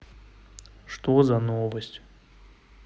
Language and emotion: Russian, sad